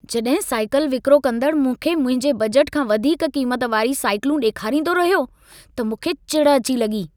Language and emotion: Sindhi, angry